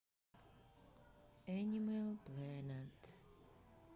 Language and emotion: Russian, sad